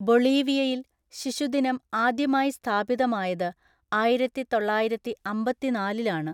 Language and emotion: Malayalam, neutral